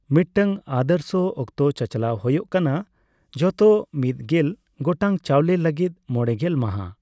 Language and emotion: Santali, neutral